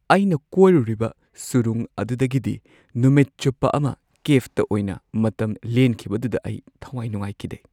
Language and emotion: Manipuri, sad